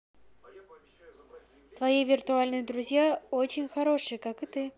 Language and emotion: Russian, positive